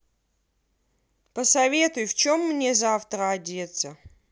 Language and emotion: Russian, angry